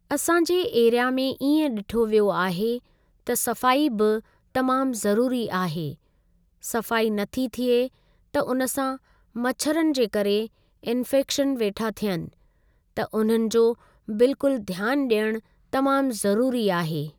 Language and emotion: Sindhi, neutral